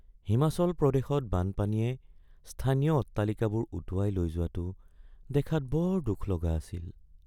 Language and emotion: Assamese, sad